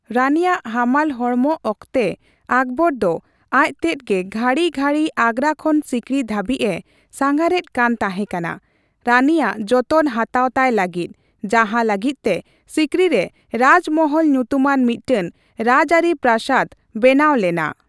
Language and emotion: Santali, neutral